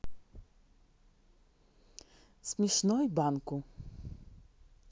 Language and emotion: Russian, neutral